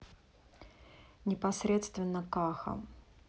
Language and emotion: Russian, neutral